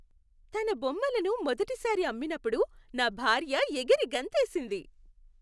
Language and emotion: Telugu, happy